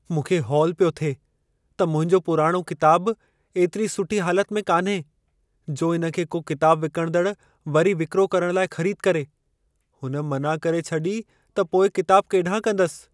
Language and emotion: Sindhi, fearful